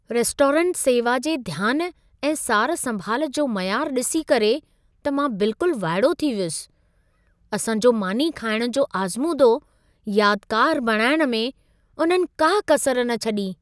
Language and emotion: Sindhi, surprised